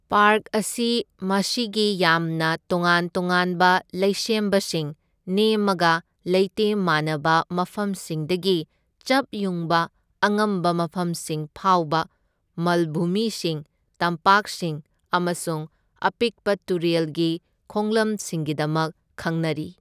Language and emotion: Manipuri, neutral